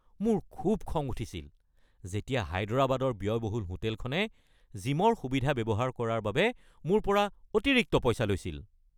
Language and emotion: Assamese, angry